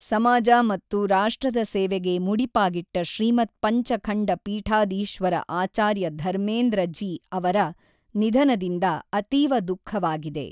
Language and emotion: Kannada, neutral